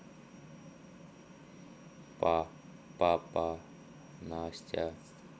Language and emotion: Russian, neutral